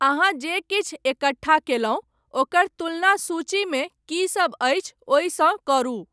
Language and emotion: Maithili, neutral